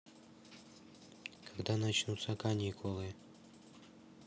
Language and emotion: Russian, neutral